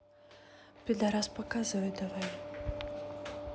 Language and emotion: Russian, sad